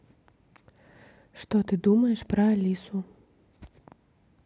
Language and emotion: Russian, neutral